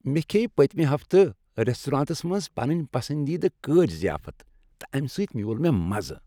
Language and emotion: Kashmiri, happy